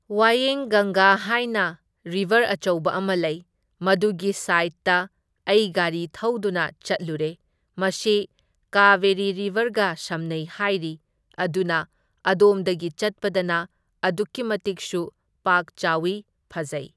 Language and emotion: Manipuri, neutral